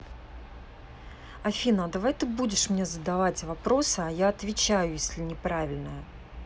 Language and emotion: Russian, neutral